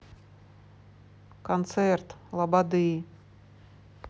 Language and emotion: Russian, neutral